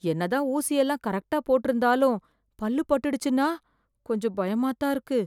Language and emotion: Tamil, fearful